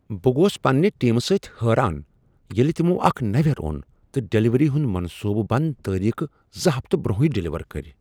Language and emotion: Kashmiri, surprised